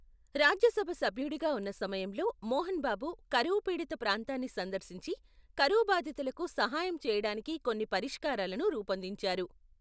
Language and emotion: Telugu, neutral